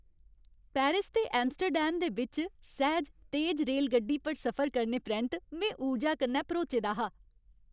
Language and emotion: Dogri, happy